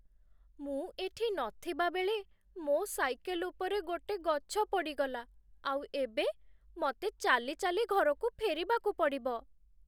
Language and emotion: Odia, sad